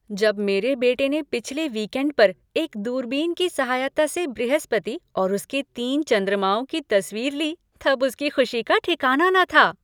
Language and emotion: Hindi, happy